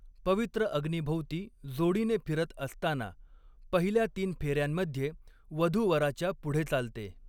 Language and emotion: Marathi, neutral